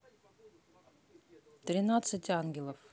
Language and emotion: Russian, neutral